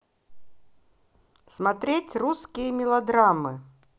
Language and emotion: Russian, positive